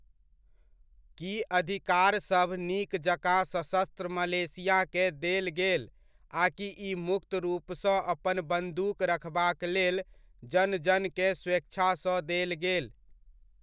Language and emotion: Maithili, neutral